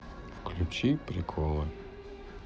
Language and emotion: Russian, sad